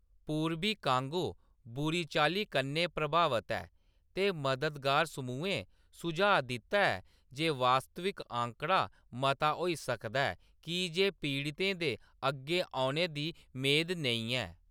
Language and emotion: Dogri, neutral